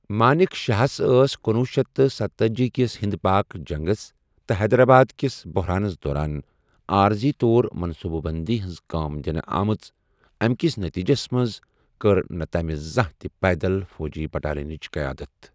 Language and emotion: Kashmiri, neutral